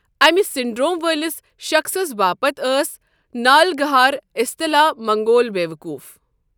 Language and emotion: Kashmiri, neutral